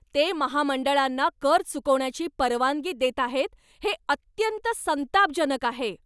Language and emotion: Marathi, angry